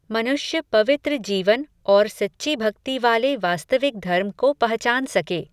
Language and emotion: Hindi, neutral